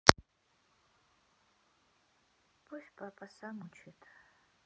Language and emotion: Russian, sad